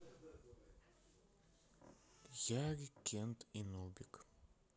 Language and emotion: Russian, sad